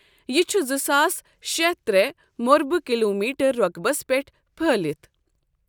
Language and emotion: Kashmiri, neutral